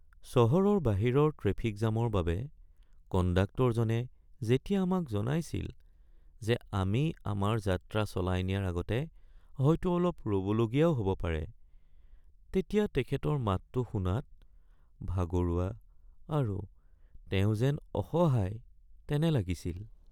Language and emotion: Assamese, sad